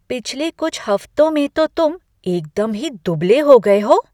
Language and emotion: Hindi, surprised